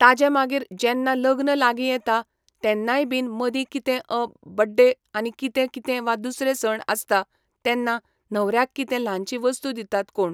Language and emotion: Goan Konkani, neutral